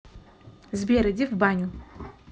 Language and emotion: Russian, neutral